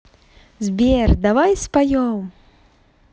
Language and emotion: Russian, positive